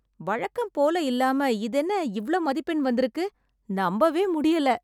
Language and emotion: Tamil, surprised